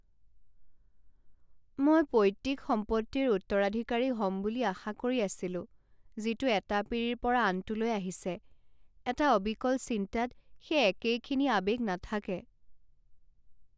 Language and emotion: Assamese, sad